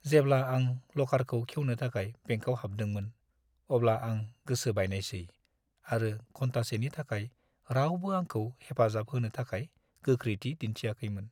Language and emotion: Bodo, sad